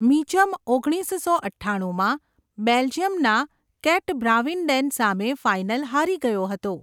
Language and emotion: Gujarati, neutral